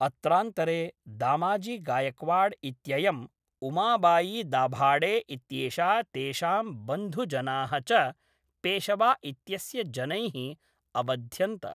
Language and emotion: Sanskrit, neutral